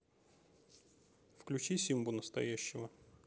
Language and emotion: Russian, neutral